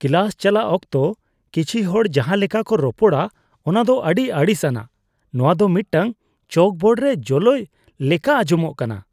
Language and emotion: Santali, disgusted